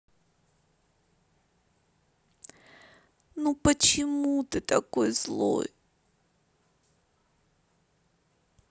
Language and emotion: Russian, sad